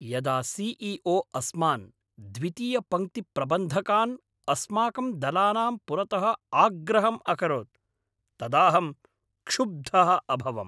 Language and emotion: Sanskrit, angry